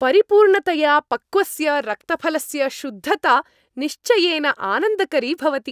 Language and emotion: Sanskrit, happy